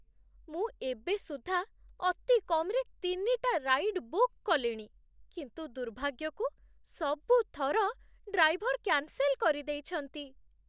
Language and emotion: Odia, sad